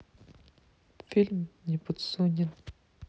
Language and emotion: Russian, neutral